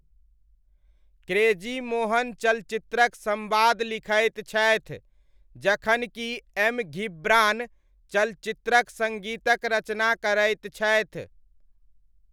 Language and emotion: Maithili, neutral